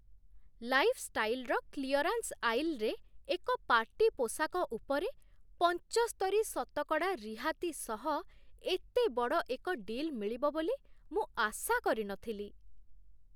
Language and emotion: Odia, surprised